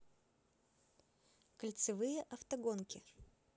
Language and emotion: Russian, neutral